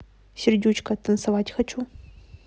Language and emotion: Russian, neutral